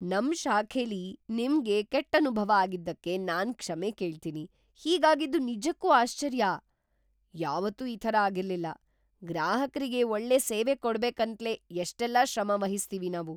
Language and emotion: Kannada, surprised